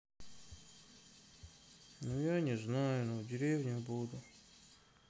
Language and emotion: Russian, sad